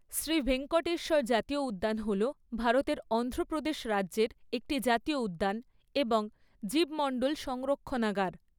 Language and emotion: Bengali, neutral